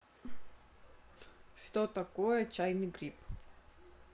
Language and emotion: Russian, neutral